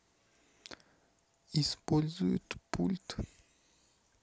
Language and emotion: Russian, neutral